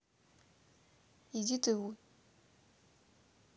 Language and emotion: Russian, neutral